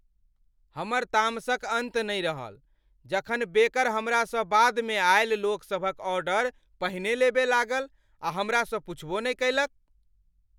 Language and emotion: Maithili, angry